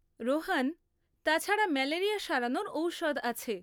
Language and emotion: Bengali, neutral